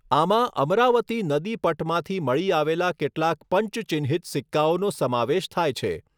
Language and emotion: Gujarati, neutral